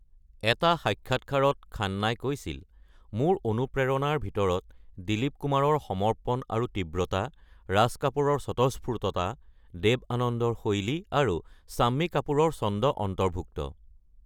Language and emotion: Assamese, neutral